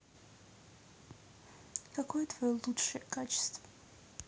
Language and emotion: Russian, neutral